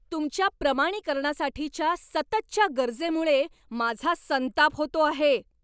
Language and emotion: Marathi, angry